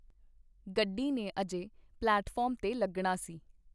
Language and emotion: Punjabi, neutral